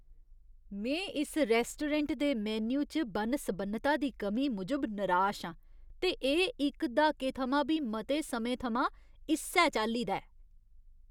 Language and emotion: Dogri, disgusted